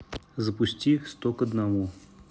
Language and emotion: Russian, neutral